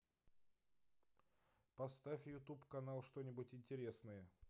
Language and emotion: Russian, neutral